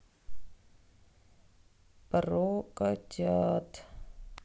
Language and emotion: Russian, sad